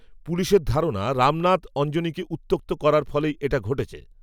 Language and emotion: Bengali, neutral